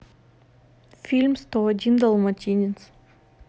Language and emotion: Russian, neutral